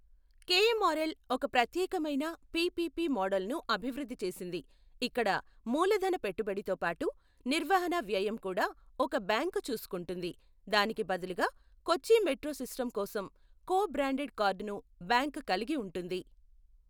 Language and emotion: Telugu, neutral